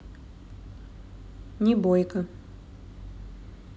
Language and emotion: Russian, neutral